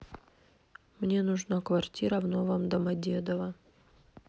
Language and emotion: Russian, neutral